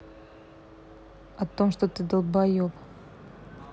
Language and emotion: Russian, angry